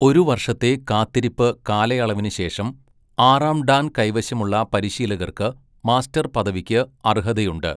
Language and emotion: Malayalam, neutral